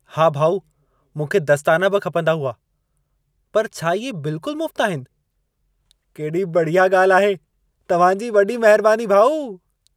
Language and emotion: Sindhi, happy